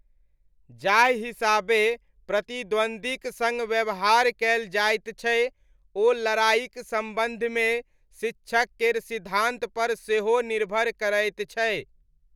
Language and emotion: Maithili, neutral